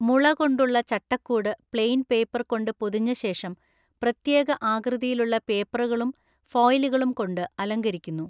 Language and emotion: Malayalam, neutral